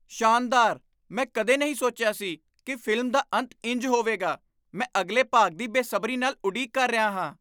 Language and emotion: Punjabi, surprised